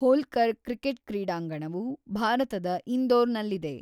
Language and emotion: Kannada, neutral